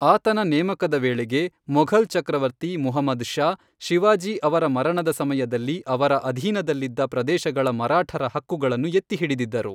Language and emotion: Kannada, neutral